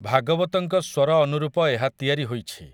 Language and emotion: Odia, neutral